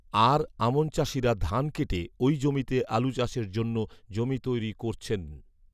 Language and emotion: Bengali, neutral